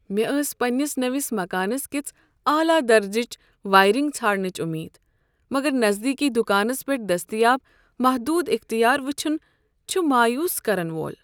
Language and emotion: Kashmiri, sad